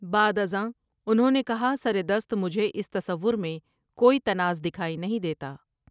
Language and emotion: Urdu, neutral